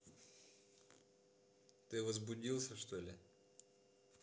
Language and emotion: Russian, neutral